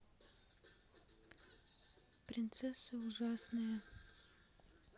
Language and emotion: Russian, sad